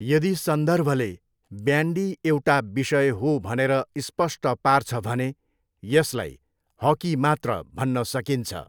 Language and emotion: Nepali, neutral